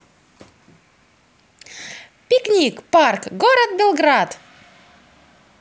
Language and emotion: Russian, positive